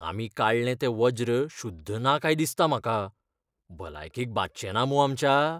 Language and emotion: Goan Konkani, fearful